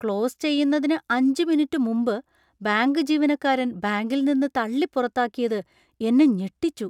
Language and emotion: Malayalam, surprised